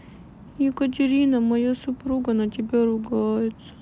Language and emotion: Russian, sad